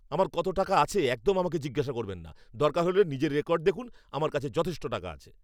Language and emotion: Bengali, angry